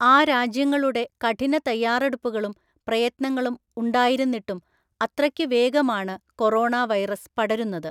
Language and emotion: Malayalam, neutral